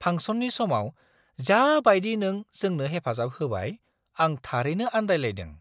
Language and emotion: Bodo, surprised